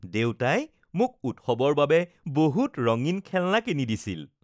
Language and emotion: Assamese, happy